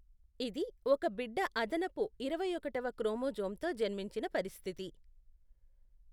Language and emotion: Telugu, neutral